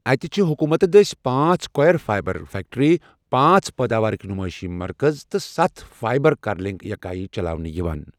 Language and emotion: Kashmiri, neutral